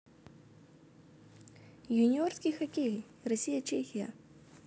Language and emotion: Russian, neutral